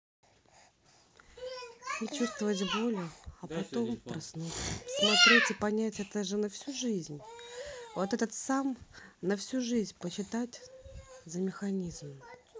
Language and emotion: Russian, neutral